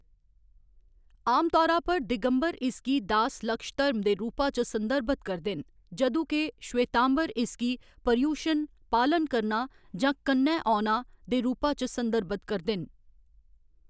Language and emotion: Dogri, neutral